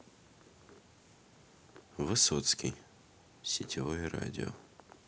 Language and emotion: Russian, neutral